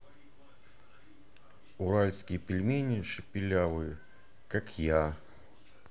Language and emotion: Russian, neutral